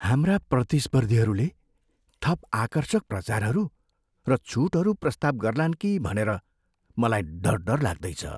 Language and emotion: Nepali, fearful